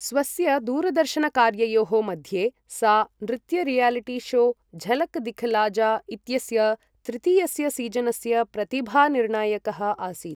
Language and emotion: Sanskrit, neutral